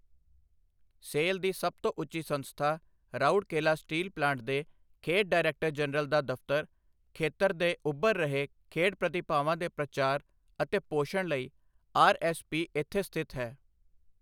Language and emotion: Punjabi, neutral